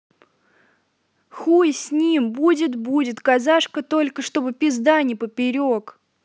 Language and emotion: Russian, angry